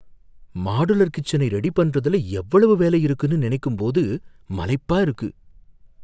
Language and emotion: Tamil, fearful